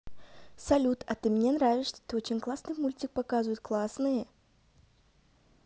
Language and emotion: Russian, positive